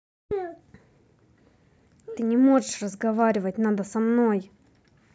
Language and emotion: Russian, angry